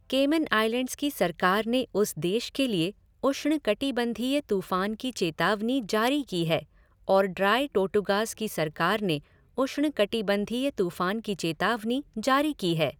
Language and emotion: Hindi, neutral